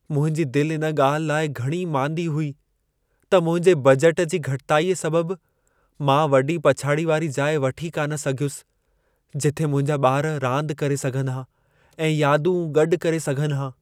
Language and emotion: Sindhi, sad